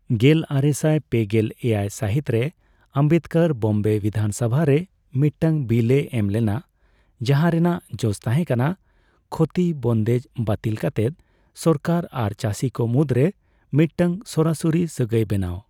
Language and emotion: Santali, neutral